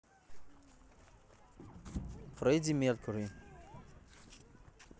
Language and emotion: Russian, neutral